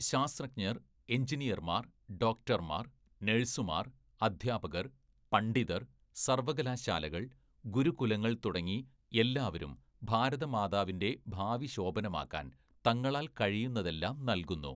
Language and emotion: Malayalam, neutral